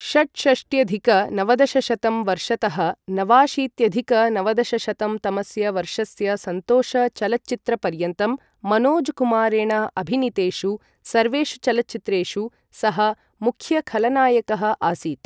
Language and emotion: Sanskrit, neutral